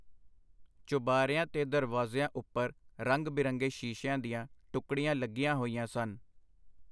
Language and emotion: Punjabi, neutral